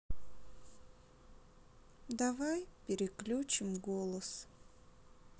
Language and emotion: Russian, sad